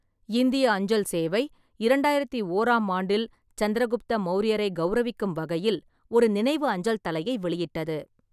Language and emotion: Tamil, neutral